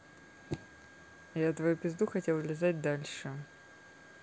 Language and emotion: Russian, neutral